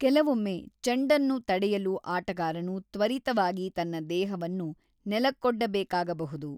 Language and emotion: Kannada, neutral